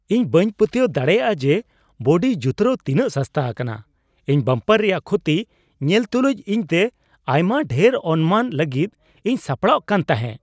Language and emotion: Santali, surprised